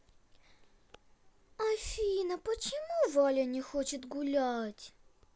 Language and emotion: Russian, sad